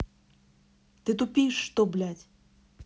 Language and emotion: Russian, angry